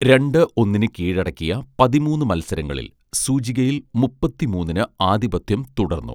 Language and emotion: Malayalam, neutral